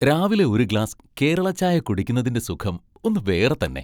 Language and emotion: Malayalam, happy